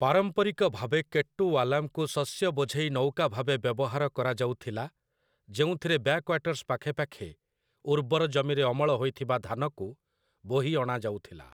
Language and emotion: Odia, neutral